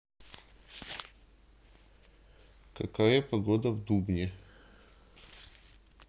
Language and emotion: Russian, neutral